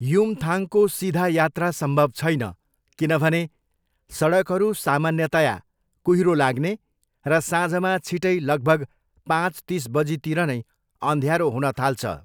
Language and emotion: Nepali, neutral